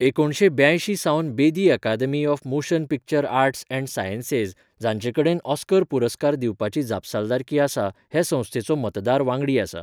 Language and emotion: Goan Konkani, neutral